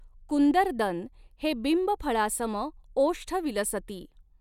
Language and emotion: Marathi, neutral